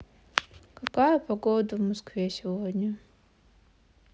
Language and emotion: Russian, sad